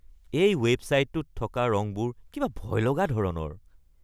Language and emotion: Assamese, disgusted